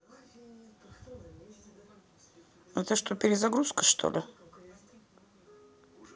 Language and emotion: Russian, neutral